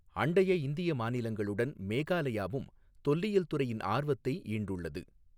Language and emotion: Tamil, neutral